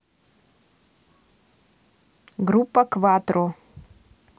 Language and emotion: Russian, neutral